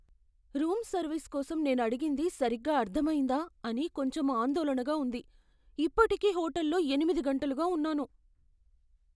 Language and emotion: Telugu, fearful